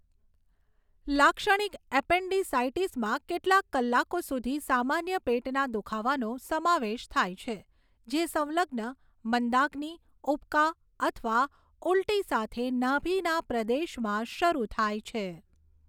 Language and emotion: Gujarati, neutral